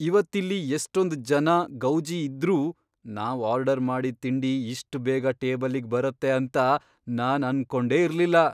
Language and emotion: Kannada, surprised